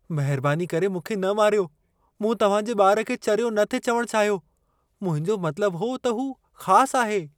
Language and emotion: Sindhi, fearful